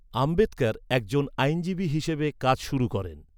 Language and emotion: Bengali, neutral